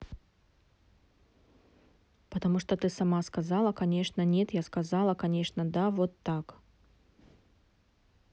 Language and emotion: Russian, neutral